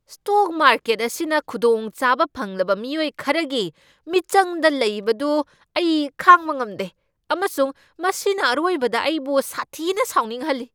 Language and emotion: Manipuri, angry